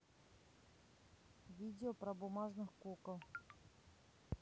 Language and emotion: Russian, neutral